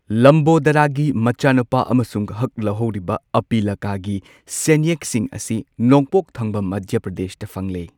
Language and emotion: Manipuri, neutral